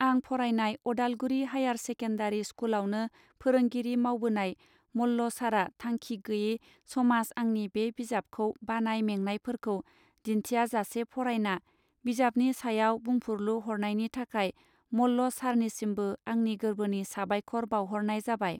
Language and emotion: Bodo, neutral